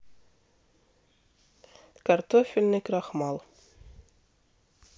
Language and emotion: Russian, neutral